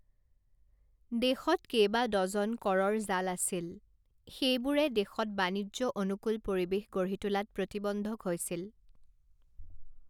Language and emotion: Assamese, neutral